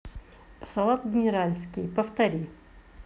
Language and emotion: Russian, neutral